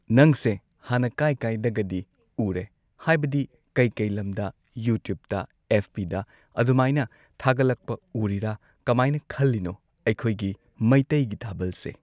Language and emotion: Manipuri, neutral